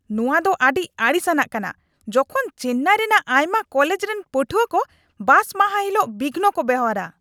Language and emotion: Santali, angry